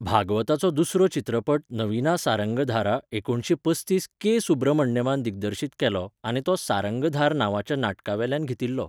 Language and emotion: Goan Konkani, neutral